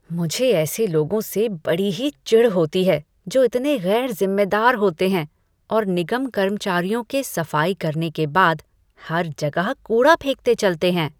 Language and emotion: Hindi, disgusted